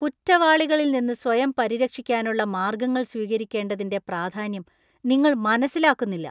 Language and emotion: Malayalam, disgusted